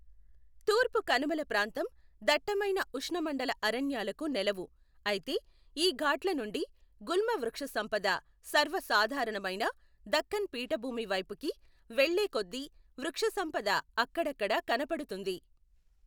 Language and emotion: Telugu, neutral